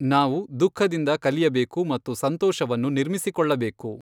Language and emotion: Kannada, neutral